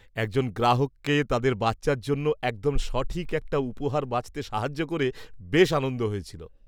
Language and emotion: Bengali, happy